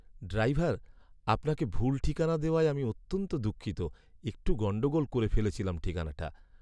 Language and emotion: Bengali, sad